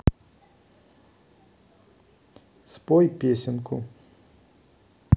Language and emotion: Russian, neutral